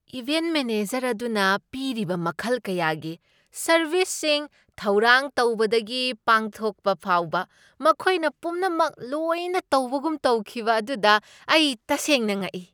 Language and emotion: Manipuri, surprised